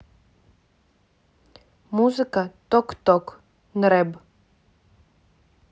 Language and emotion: Russian, neutral